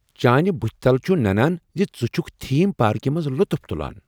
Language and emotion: Kashmiri, happy